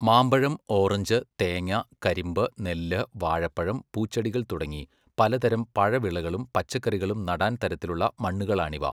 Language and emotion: Malayalam, neutral